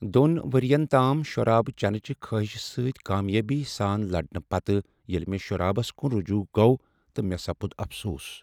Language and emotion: Kashmiri, sad